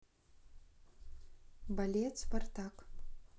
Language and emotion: Russian, neutral